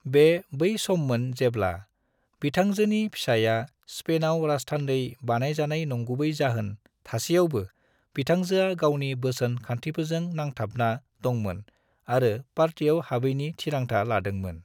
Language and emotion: Bodo, neutral